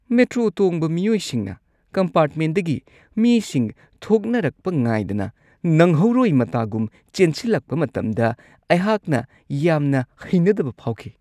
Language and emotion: Manipuri, disgusted